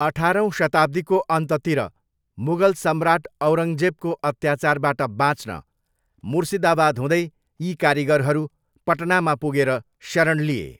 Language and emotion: Nepali, neutral